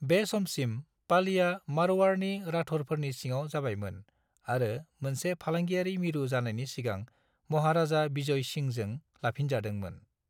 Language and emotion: Bodo, neutral